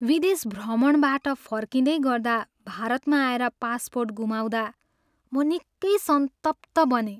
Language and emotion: Nepali, sad